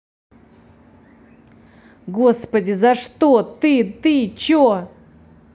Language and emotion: Russian, angry